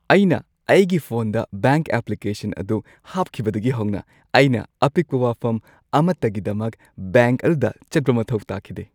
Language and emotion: Manipuri, happy